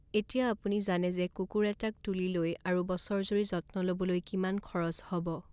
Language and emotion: Assamese, neutral